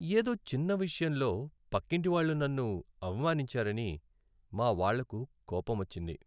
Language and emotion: Telugu, sad